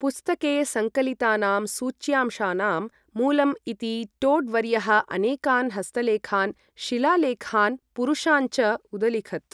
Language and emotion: Sanskrit, neutral